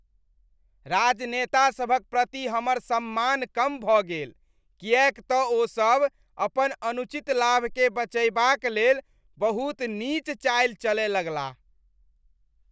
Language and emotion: Maithili, disgusted